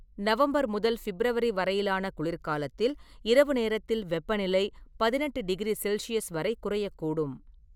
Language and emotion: Tamil, neutral